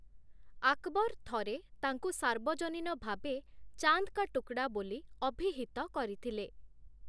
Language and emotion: Odia, neutral